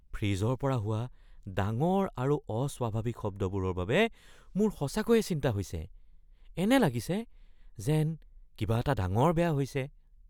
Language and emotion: Assamese, fearful